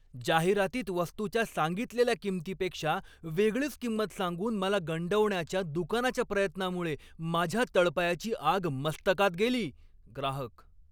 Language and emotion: Marathi, angry